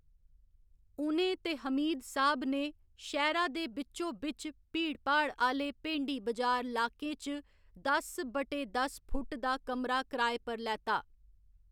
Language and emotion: Dogri, neutral